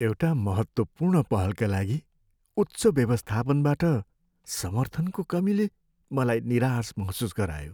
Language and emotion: Nepali, sad